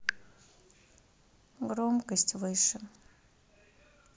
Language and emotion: Russian, sad